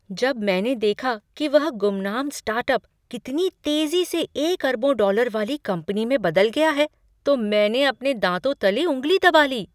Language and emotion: Hindi, surprised